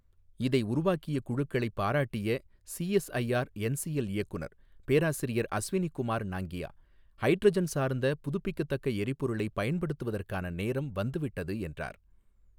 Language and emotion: Tamil, neutral